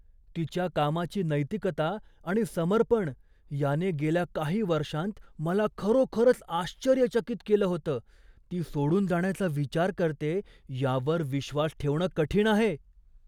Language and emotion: Marathi, surprised